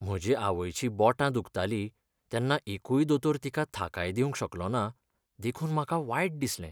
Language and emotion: Goan Konkani, sad